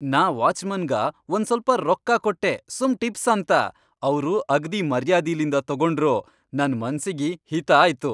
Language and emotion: Kannada, happy